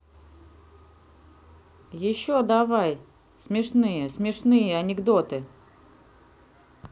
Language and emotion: Russian, neutral